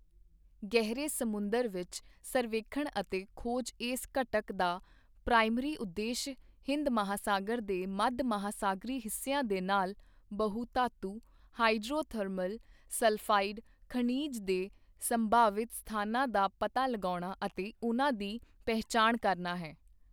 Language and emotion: Punjabi, neutral